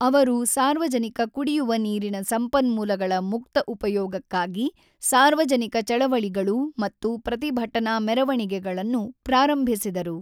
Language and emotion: Kannada, neutral